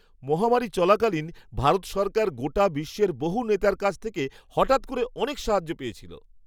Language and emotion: Bengali, surprised